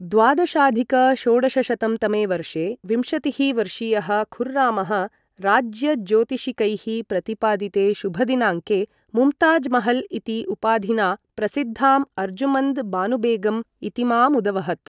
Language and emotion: Sanskrit, neutral